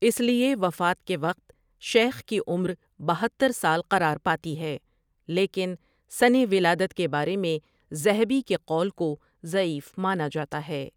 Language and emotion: Urdu, neutral